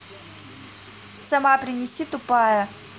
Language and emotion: Russian, angry